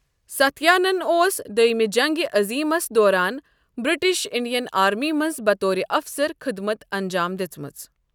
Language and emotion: Kashmiri, neutral